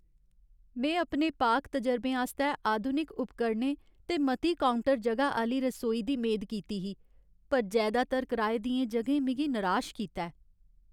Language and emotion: Dogri, sad